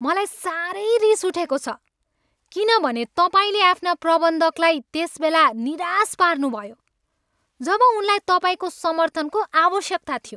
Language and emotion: Nepali, angry